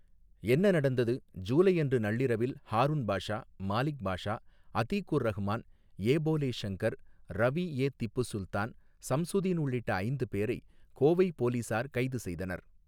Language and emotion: Tamil, neutral